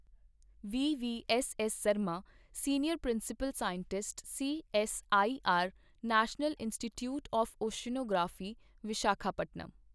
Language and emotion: Punjabi, neutral